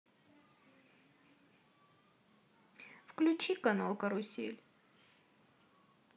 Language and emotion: Russian, sad